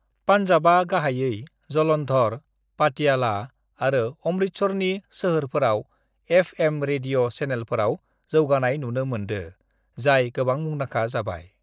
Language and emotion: Bodo, neutral